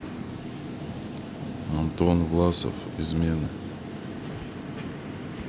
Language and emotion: Russian, neutral